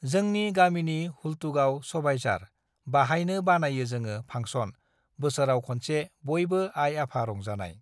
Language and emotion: Bodo, neutral